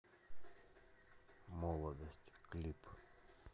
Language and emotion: Russian, neutral